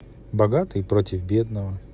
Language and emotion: Russian, neutral